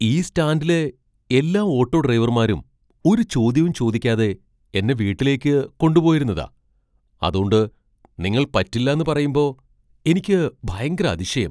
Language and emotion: Malayalam, surprised